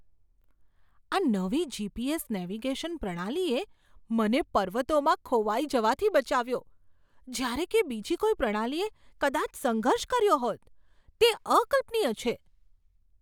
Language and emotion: Gujarati, surprised